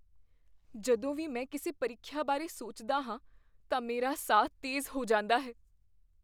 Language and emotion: Punjabi, fearful